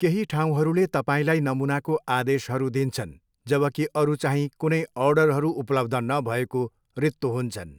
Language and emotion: Nepali, neutral